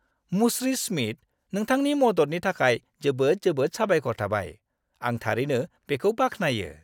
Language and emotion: Bodo, happy